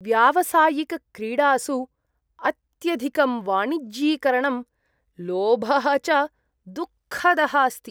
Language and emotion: Sanskrit, disgusted